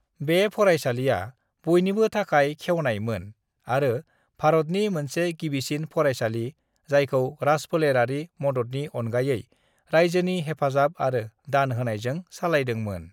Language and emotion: Bodo, neutral